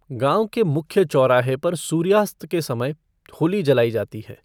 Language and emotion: Hindi, neutral